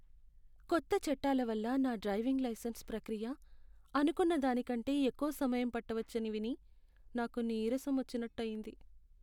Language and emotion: Telugu, sad